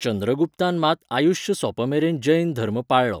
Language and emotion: Goan Konkani, neutral